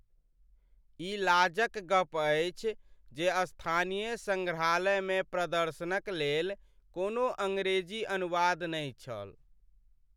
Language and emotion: Maithili, sad